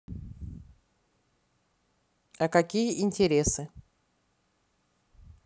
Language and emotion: Russian, neutral